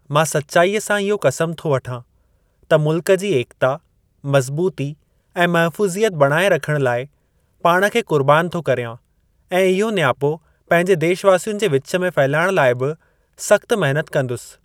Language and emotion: Sindhi, neutral